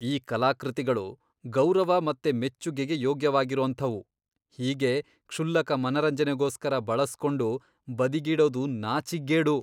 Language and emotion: Kannada, disgusted